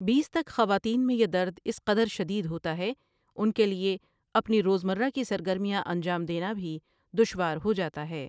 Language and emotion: Urdu, neutral